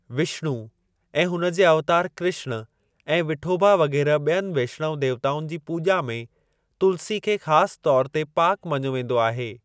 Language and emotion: Sindhi, neutral